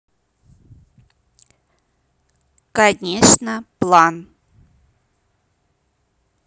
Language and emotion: Russian, neutral